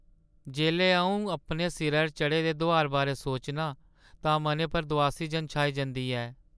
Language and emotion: Dogri, sad